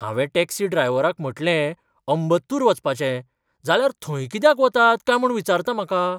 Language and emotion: Goan Konkani, surprised